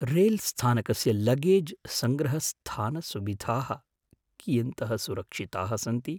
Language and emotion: Sanskrit, fearful